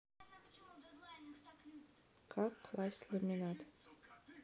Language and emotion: Russian, neutral